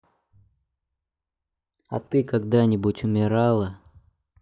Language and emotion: Russian, sad